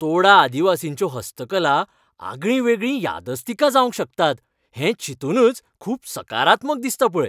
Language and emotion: Goan Konkani, happy